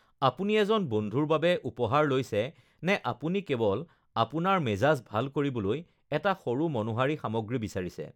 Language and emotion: Assamese, neutral